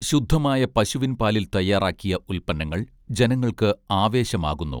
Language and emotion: Malayalam, neutral